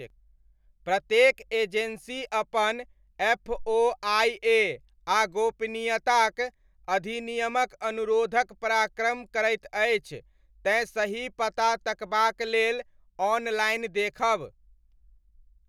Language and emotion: Maithili, neutral